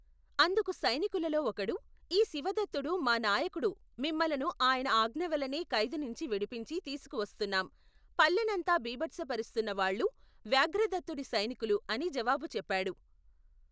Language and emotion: Telugu, neutral